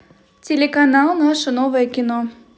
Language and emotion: Russian, positive